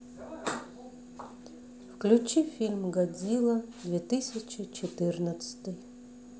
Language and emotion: Russian, sad